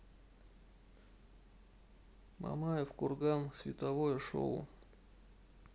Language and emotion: Russian, neutral